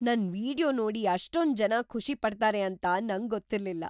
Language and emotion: Kannada, surprised